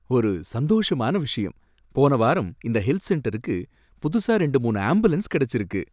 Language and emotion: Tamil, happy